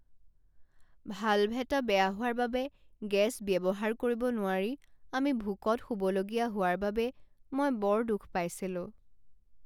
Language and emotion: Assamese, sad